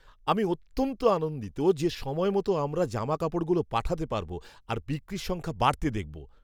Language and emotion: Bengali, happy